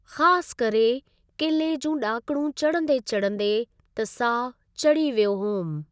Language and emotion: Sindhi, neutral